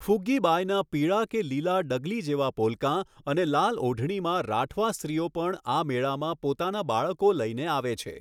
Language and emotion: Gujarati, neutral